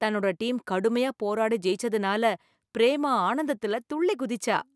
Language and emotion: Tamil, happy